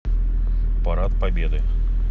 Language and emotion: Russian, neutral